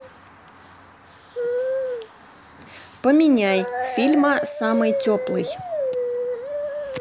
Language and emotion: Russian, neutral